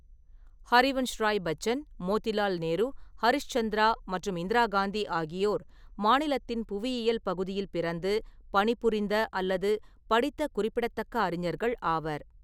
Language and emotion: Tamil, neutral